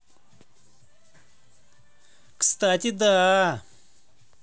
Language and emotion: Russian, positive